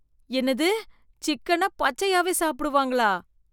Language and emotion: Tamil, disgusted